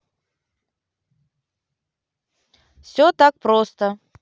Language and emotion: Russian, positive